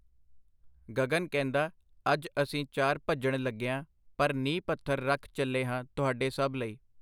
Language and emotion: Punjabi, neutral